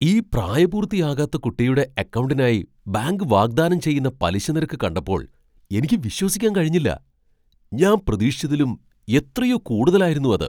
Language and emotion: Malayalam, surprised